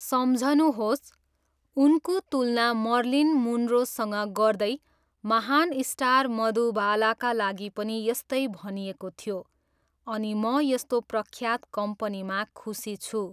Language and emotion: Nepali, neutral